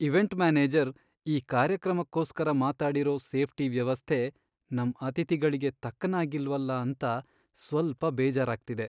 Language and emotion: Kannada, sad